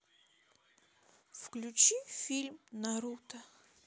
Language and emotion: Russian, sad